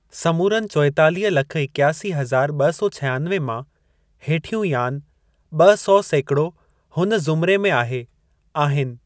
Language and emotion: Sindhi, neutral